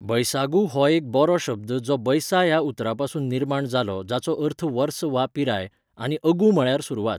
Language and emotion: Goan Konkani, neutral